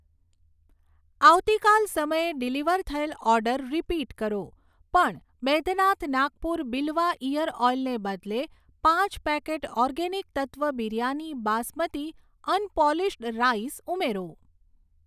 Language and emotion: Gujarati, neutral